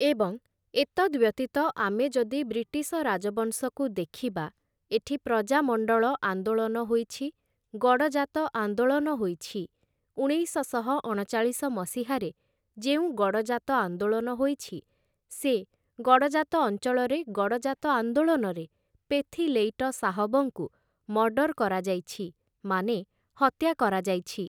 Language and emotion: Odia, neutral